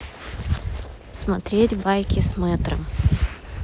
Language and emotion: Russian, neutral